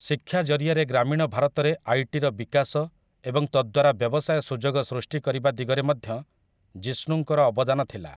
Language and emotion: Odia, neutral